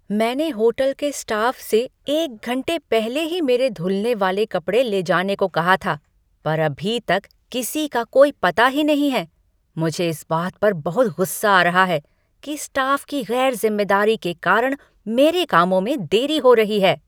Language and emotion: Hindi, angry